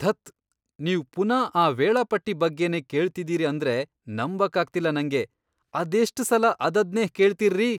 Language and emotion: Kannada, disgusted